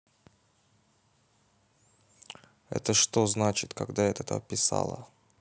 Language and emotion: Russian, neutral